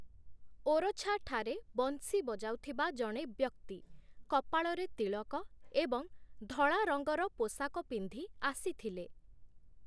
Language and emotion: Odia, neutral